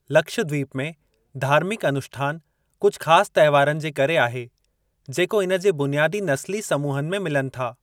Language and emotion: Sindhi, neutral